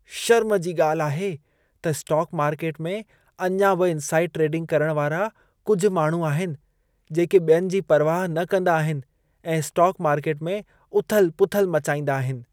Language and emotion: Sindhi, disgusted